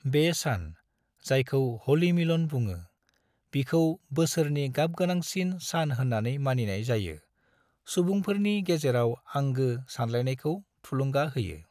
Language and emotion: Bodo, neutral